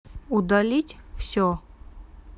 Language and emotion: Russian, neutral